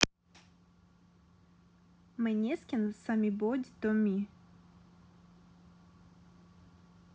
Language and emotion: Russian, neutral